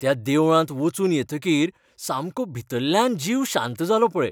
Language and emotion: Goan Konkani, happy